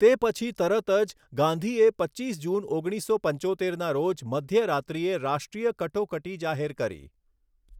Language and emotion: Gujarati, neutral